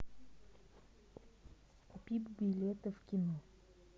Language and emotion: Russian, neutral